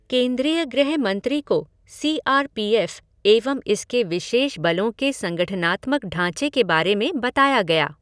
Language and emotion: Hindi, neutral